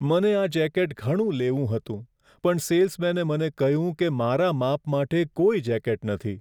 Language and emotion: Gujarati, sad